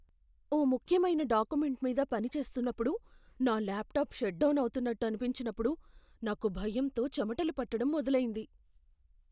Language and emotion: Telugu, fearful